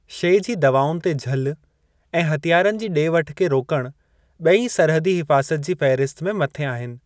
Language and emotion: Sindhi, neutral